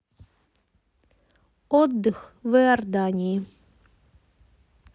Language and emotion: Russian, neutral